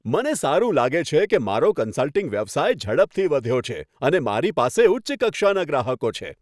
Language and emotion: Gujarati, happy